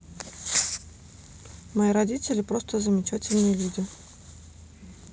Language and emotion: Russian, neutral